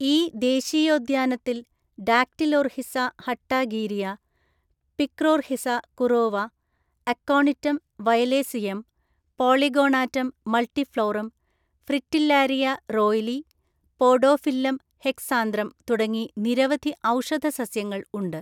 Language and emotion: Malayalam, neutral